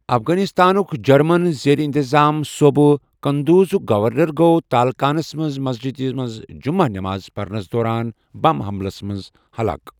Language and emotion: Kashmiri, neutral